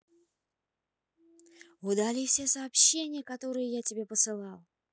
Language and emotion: Russian, neutral